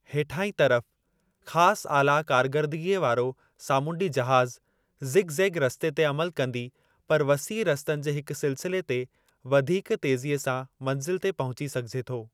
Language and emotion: Sindhi, neutral